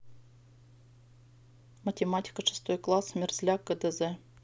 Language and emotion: Russian, neutral